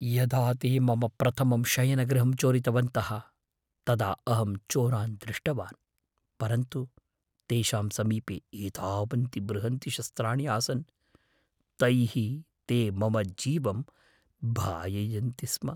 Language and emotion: Sanskrit, fearful